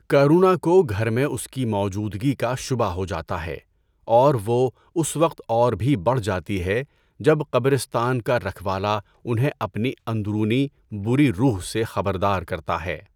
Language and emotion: Urdu, neutral